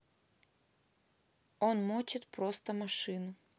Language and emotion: Russian, neutral